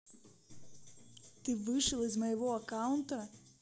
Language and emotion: Russian, neutral